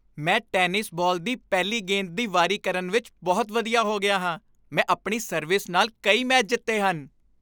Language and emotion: Punjabi, happy